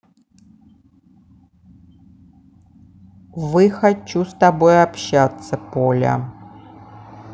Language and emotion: Russian, neutral